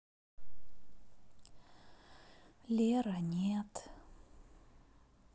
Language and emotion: Russian, sad